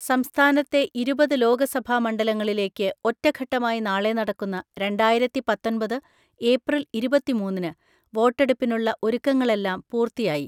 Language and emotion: Malayalam, neutral